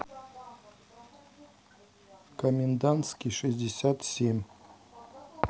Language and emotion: Russian, neutral